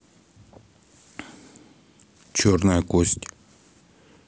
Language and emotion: Russian, neutral